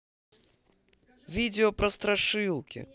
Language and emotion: Russian, positive